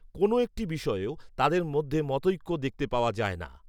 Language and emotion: Bengali, neutral